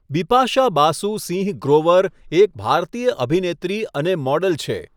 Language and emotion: Gujarati, neutral